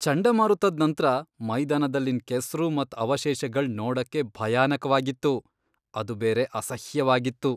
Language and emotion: Kannada, disgusted